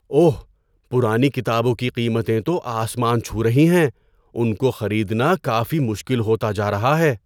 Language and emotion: Urdu, surprised